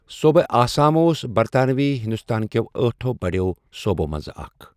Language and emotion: Kashmiri, neutral